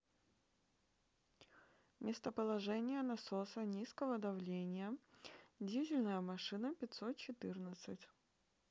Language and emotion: Russian, neutral